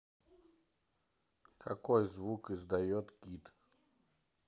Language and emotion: Russian, neutral